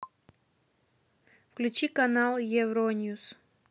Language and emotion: Russian, neutral